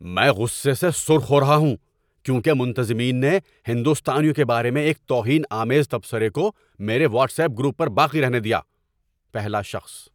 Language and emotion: Urdu, angry